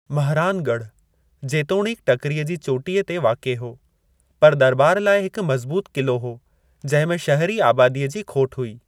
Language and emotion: Sindhi, neutral